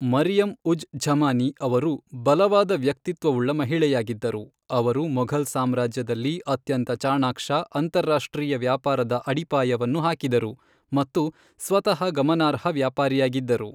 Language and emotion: Kannada, neutral